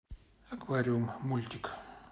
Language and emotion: Russian, neutral